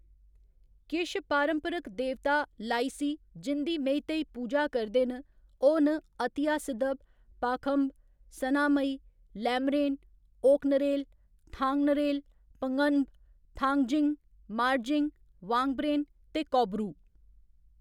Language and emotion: Dogri, neutral